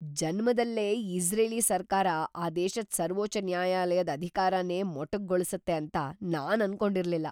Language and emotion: Kannada, surprised